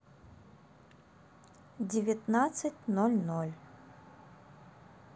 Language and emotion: Russian, neutral